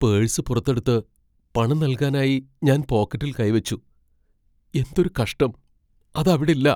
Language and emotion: Malayalam, fearful